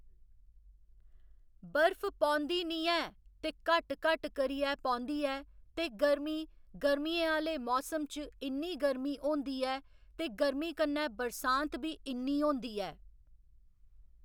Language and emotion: Dogri, neutral